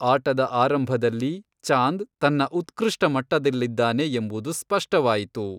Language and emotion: Kannada, neutral